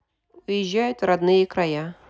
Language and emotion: Russian, neutral